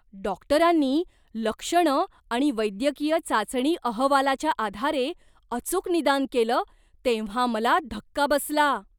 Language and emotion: Marathi, surprised